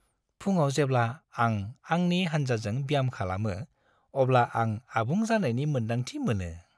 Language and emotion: Bodo, happy